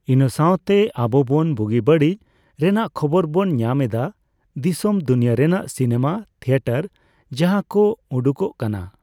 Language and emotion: Santali, neutral